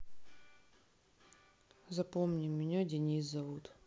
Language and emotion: Russian, sad